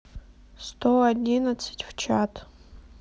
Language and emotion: Russian, neutral